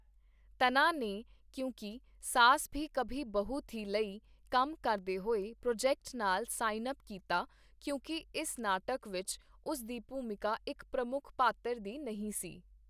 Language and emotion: Punjabi, neutral